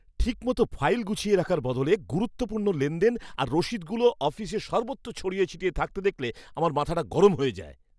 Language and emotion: Bengali, angry